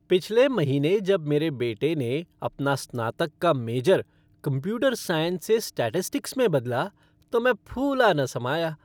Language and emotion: Hindi, happy